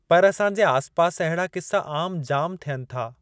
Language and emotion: Sindhi, neutral